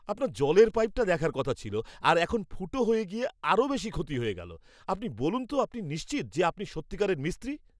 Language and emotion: Bengali, angry